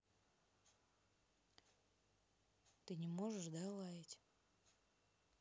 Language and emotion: Russian, neutral